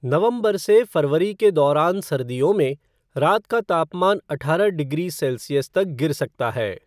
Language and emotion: Hindi, neutral